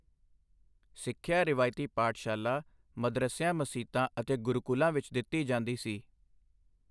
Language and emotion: Punjabi, neutral